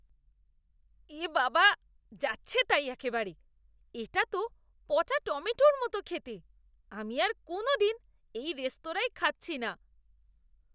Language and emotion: Bengali, disgusted